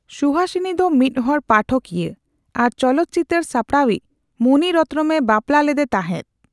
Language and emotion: Santali, neutral